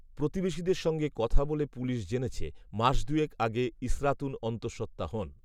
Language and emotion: Bengali, neutral